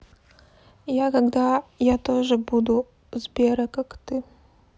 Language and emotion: Russian, sad